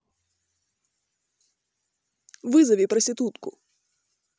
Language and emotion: Russian, neutral